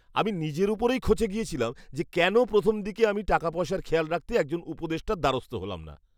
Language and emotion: Bengali, angry